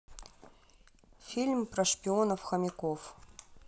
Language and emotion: Russian, neutral